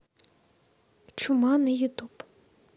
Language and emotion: Russian, neutral